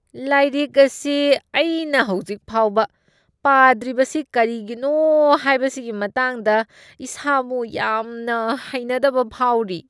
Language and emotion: Manipuri, disgusted